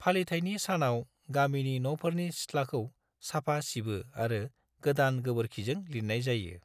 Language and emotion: Bodo, neutral